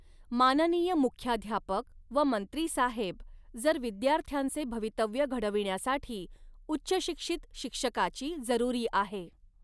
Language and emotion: Marathi, neutral